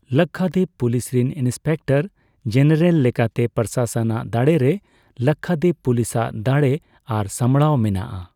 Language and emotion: Santali, neutral